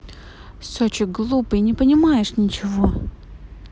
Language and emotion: Russian, angry